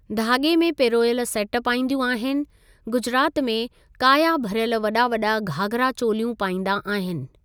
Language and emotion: Sindhi, neutral